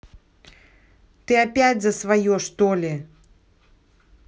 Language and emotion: Russian, angry